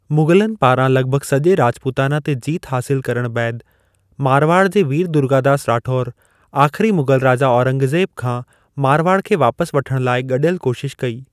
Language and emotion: Sindhi, neutral